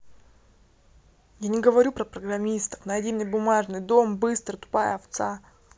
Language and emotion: Russian, angry